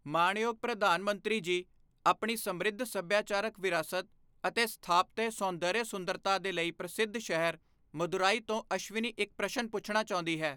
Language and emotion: Punjabi, neutral